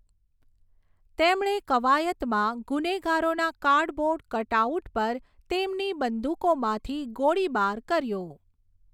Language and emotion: Gujarati, neutral